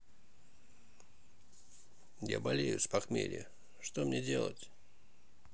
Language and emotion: Russian, sad